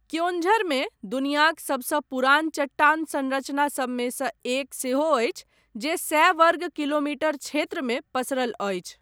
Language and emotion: Maithili, neutral